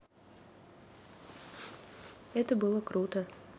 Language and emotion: Russian, neutral